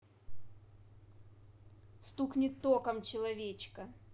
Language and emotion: Russian, neutral